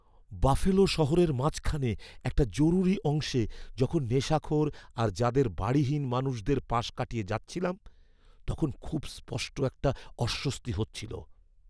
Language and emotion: Bengali, fearful